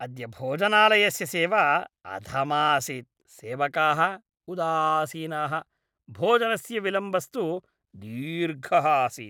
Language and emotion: Sanskrit, disgusted